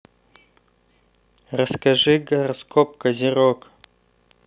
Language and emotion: Russian, neutral